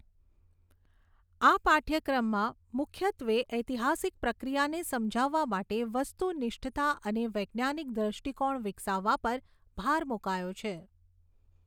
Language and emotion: Gujarati, neutral